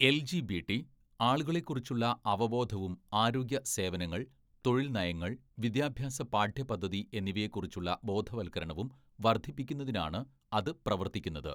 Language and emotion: Malayalam, neutral